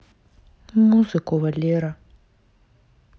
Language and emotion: Russian, sad